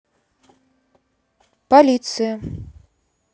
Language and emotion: Russian, neutral